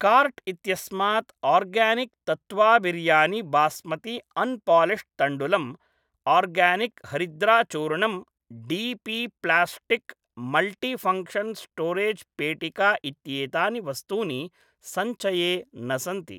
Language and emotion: Sanskrit, neutral